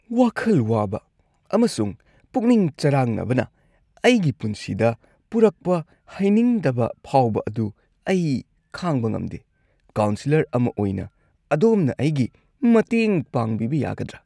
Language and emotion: Manipuri, disgusted